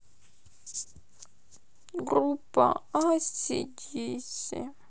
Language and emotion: Russian, sad